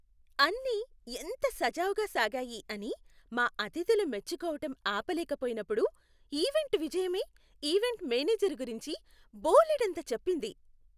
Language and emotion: Telugu, happy